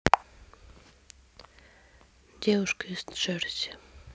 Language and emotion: Russian, sad